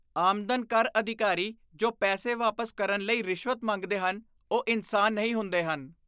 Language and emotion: Punjabi, disgusted